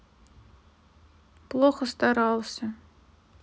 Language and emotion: Russian, sad